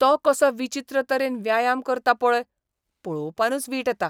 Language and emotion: Goan Konkani, disgusted